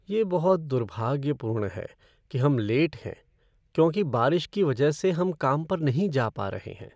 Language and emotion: Hindi, sad